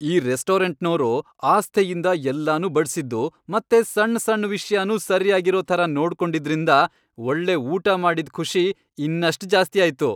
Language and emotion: Kannada, happy